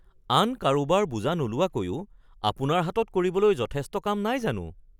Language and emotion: Assamese, surprised